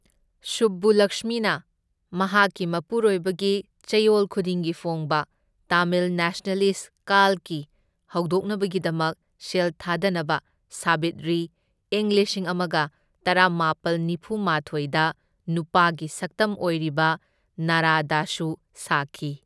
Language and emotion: Manipuri, neutral